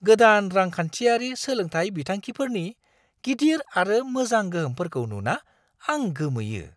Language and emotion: Bodo, surprised